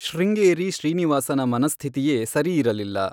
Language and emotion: Kannada, neutral